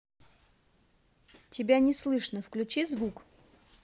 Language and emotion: Russian, neutral